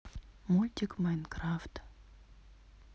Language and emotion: Russian, neutral